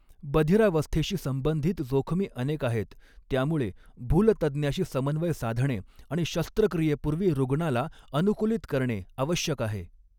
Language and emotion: Marathi, neutral